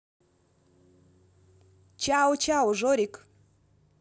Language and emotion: Russian, positive